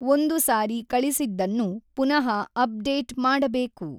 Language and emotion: Kannada, neutral